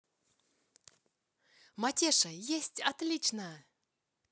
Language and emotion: Russian, positive